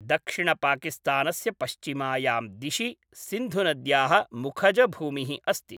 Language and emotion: Sanskrit, neutral